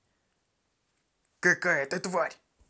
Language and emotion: Russian, angry